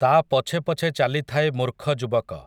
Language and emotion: Odia, neutral